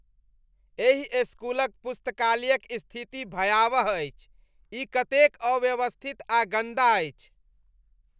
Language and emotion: Maithili, disgusted